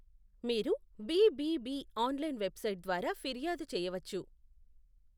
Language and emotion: Telugu, neutral